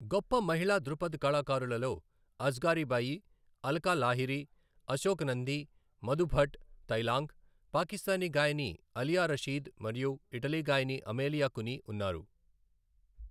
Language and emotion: Telugu, neutral